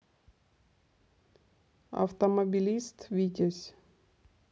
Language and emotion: Russian, neutral